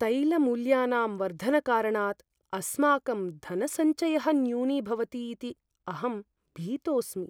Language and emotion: Sanskrit, fearful